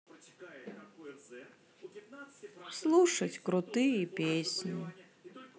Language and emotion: Russian, sad